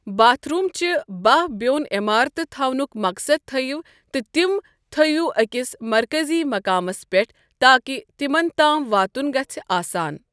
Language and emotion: Kashmiri, neutral